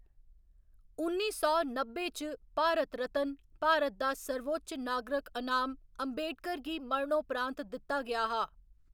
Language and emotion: Dogri, neutral